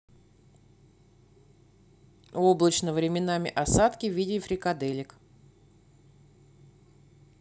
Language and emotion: Russian, neutral